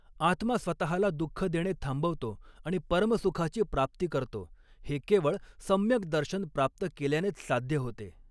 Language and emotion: Marathi, neutral